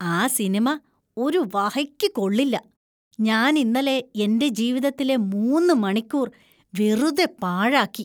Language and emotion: Malayalam, disgusted